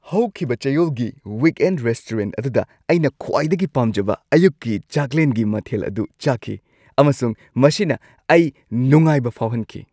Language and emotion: Manipuri, happy